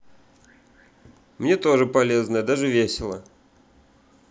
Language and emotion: Russian, neutral